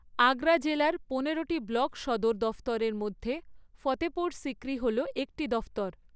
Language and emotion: Bengali, neutral